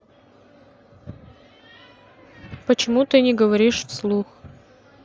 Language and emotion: Russian, neutral